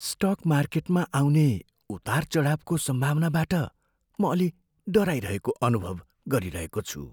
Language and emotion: Nepali, fearful